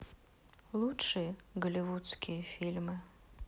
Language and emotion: Russian, sad